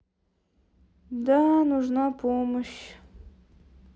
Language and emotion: Russian, sad